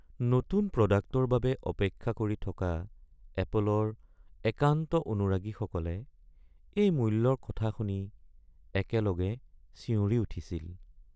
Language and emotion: Assamese, sad